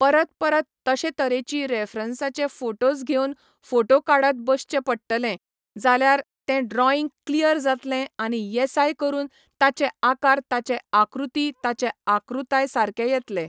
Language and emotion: Goan Konkani, neutral